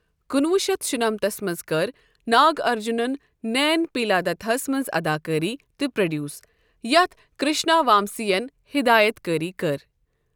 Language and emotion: Kashmiri, neutral